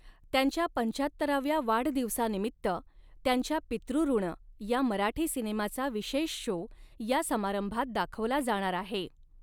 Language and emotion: Marathi, neutral